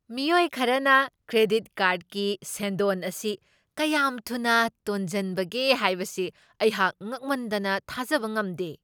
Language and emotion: Manipuri, surprised